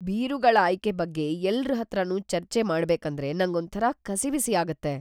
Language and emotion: Kannada, fearful